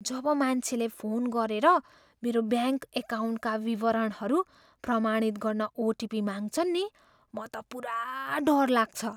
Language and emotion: Nepali, fearful